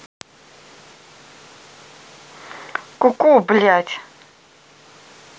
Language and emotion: Russian, angry